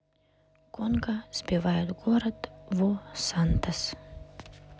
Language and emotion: Russian, neutral